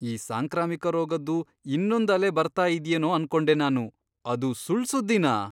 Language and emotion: Kannada, surprised